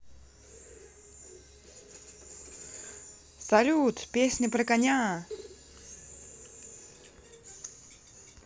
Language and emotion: Russian, positive